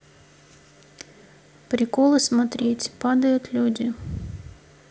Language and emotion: Russian, neutral